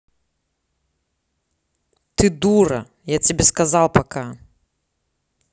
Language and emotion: Russian, angry